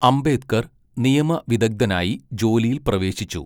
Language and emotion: Malayalam, neutral